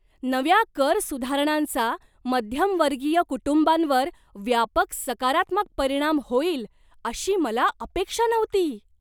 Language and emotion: Marathi, surprised